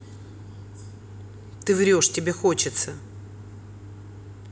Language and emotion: Russian, neutral